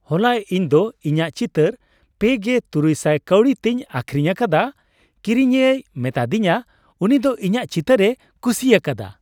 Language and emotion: Santali, happy